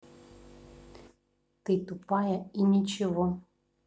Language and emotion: Russian, neutral